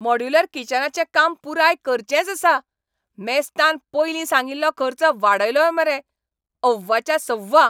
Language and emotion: Goan Konkani, angry